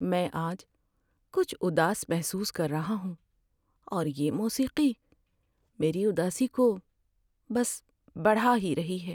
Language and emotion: Urdu, sad